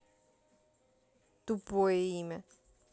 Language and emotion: Russian, neutral